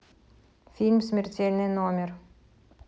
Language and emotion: Russian, neutral